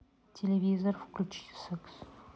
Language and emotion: Russian, neutral